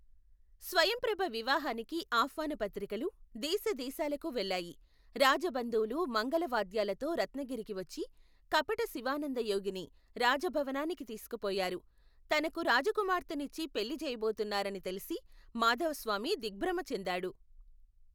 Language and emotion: Telugu, neutral